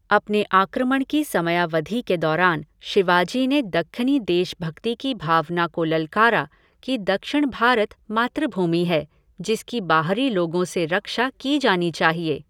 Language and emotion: Hindi, neutral